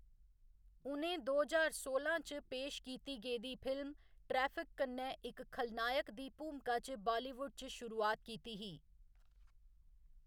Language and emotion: Dogri, neutral